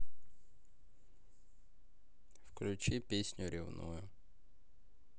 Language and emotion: Russian, neutral